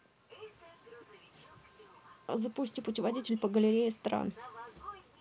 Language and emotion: Russian, neutral